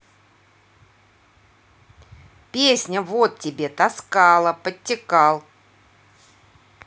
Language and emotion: Russian, neutral